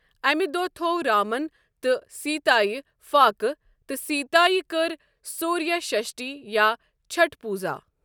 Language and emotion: Kashmiri, neutral